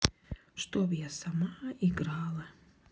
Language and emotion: Russian, sad